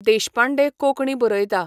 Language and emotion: Goan Konkani, neutral